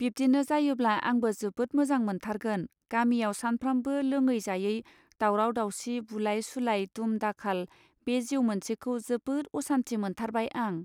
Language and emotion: Bodo, neutral